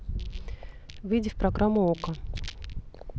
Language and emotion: Russian, neutral